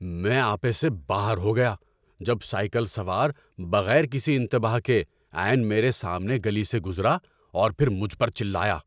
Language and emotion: Urdu, angry